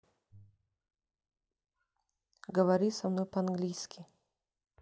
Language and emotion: Russian, neutral